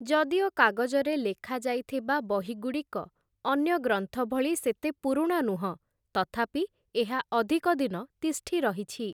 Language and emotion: Odia, neutral